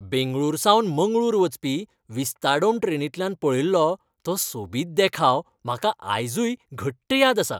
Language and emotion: Goan Konkani, happy